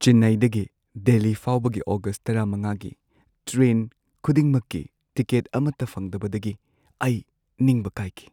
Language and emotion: Manipuri, sad